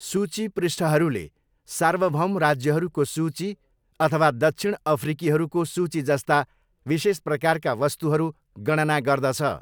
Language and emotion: Nepali, neutral